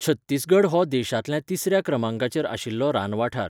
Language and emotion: Goan Konkani, neutral